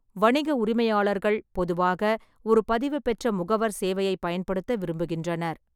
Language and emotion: Tamil, neutral